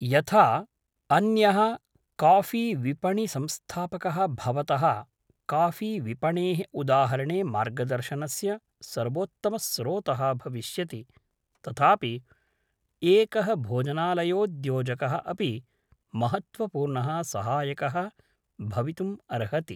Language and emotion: Sanskrit, neutral